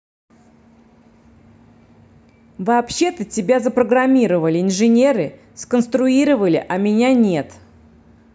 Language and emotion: Russian, angry